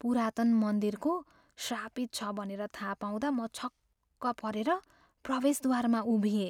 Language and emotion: Nepali, fearful